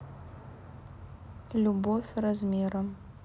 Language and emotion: Russian, sad